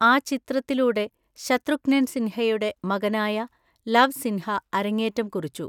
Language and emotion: Malayalam, neutral